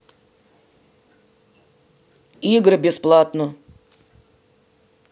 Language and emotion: Russian, neutral